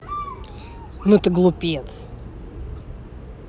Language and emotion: Russian, angry